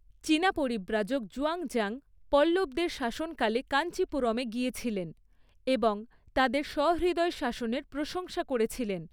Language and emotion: Bengali, neutral